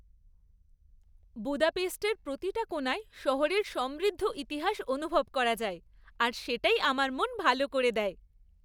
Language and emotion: Bengali, happy